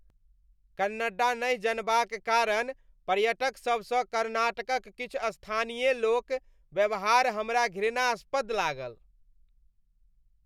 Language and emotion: Maithili, disgusted